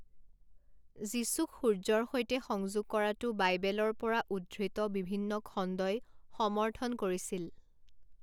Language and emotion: Assamese, neutral